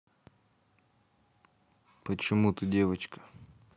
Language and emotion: Russian, neutral